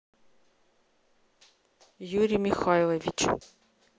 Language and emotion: Russian, neutral